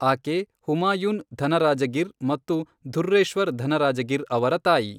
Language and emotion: Kannada, neutral